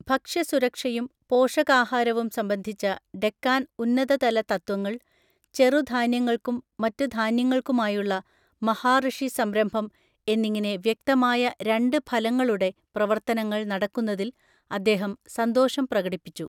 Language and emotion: Malayalam, neutral